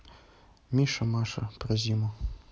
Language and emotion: Russian, neutral